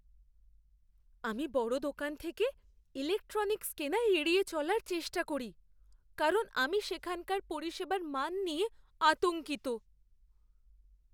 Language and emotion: Bengali, fearful